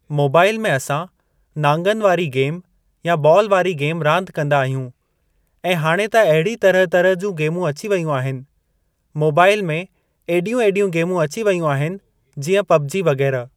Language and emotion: Sindhi, neutral